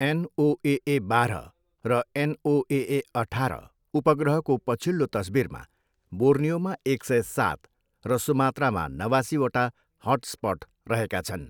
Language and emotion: Nepali, neutral